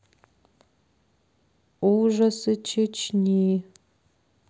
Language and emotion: Russian, sad